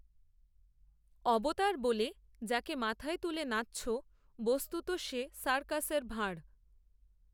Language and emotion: Bengali, neutral